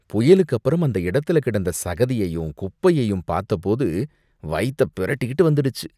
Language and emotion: Tamil, disgusted